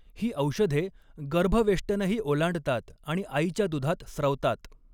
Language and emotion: Marathi, neutral